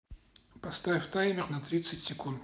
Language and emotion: Russian, neutral